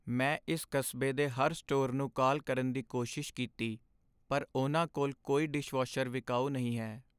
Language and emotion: Punjabi, sad